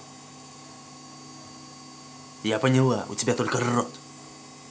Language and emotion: Russian, angry